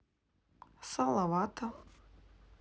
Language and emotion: Russian, neutral